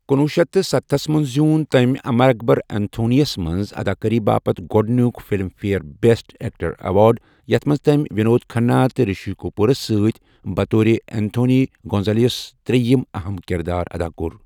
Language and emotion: Kashmiri, neutral